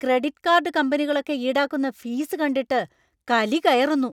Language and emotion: Malayalam, angry